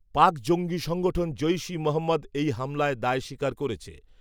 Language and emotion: Bengali, neutral